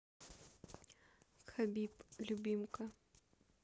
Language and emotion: Russian, neutral